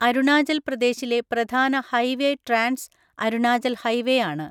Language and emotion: Malayalam, neutral